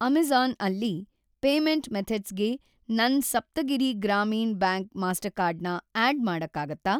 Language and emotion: Kannada, neutral